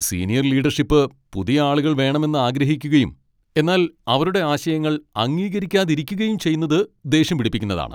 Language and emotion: Malayalam, angry